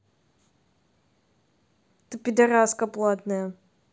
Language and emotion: Russian, angry